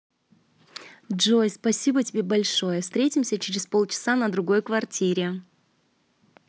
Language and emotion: Russian, positive